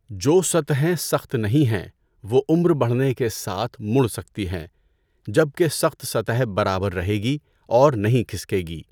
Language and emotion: Urdu, neutral